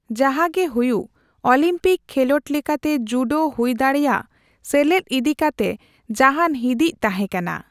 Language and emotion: Santali, neutral